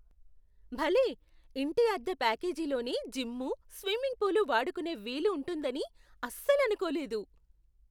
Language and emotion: Telugu, surprised